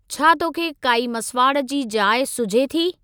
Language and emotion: Sindhi, neutral